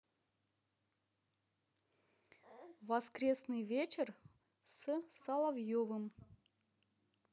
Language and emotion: Russian, neutral